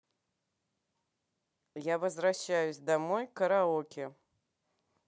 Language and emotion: Russian, neutral